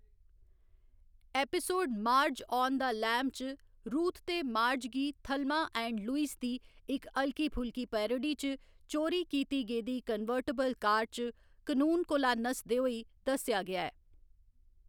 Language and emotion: Dogri, neutral